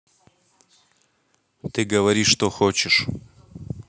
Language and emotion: Russian, neutral